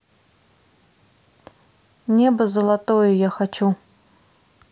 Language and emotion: Russian, neutral